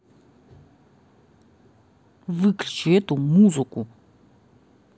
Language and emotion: Russian, angry